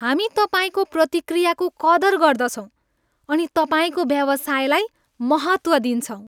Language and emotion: Nepali, happy